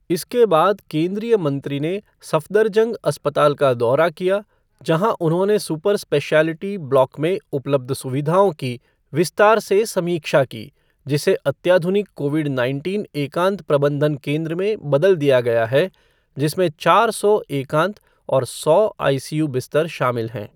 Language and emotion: Hindi, neutral